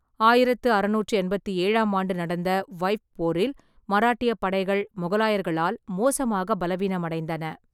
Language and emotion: Tamil, neutral